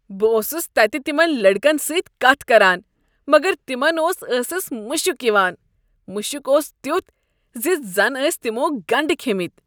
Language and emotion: Kashmiri, disgusted